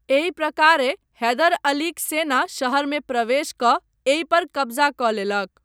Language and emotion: Maithili, neutral